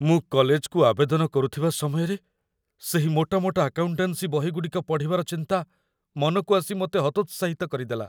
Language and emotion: Odia, fearful